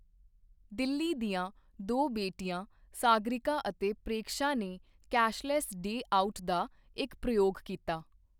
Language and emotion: Punjabi, neutral